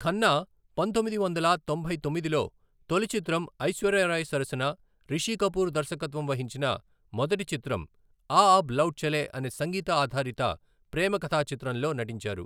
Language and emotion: Telugu, neutral